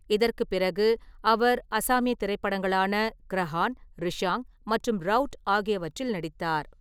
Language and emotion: Tamil, neutral